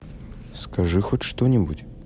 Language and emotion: Russian, neutral